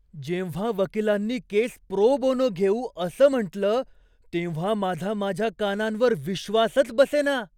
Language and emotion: Marathi, surprised